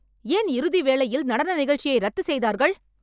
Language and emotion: Tamil, angry